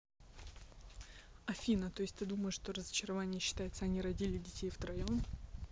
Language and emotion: Russian, neutral